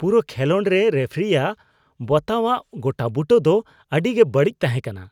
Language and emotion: Santali, disgusted